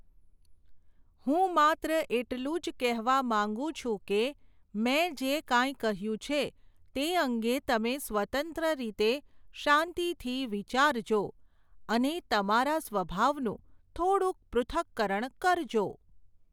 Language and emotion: Gujarati, neutral